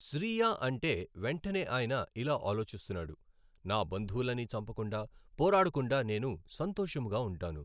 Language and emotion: Telugu, neutral